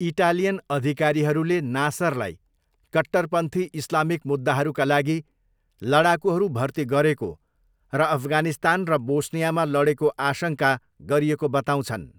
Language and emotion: Nepali, neutral